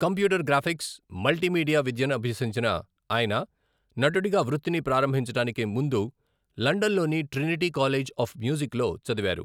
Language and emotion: Telugu, neutral